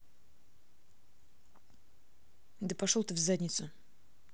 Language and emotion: Russian, angry